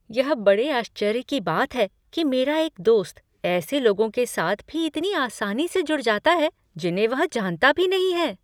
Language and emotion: Hindi, surprised